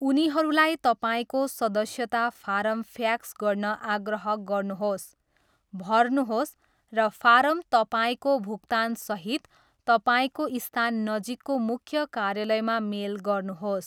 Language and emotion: Nepali, neutral